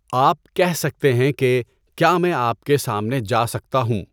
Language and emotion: Urdu, neutral